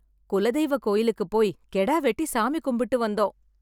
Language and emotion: Tamil, happy